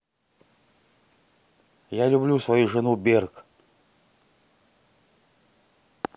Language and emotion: Russian, neutral